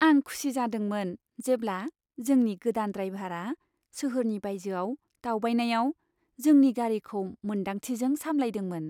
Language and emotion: Bodo, happy